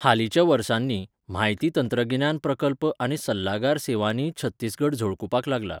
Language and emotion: Goan Konkani, neutral